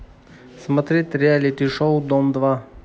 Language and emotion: Russian, neutral